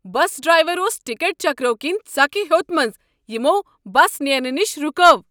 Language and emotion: Kashmiri, angry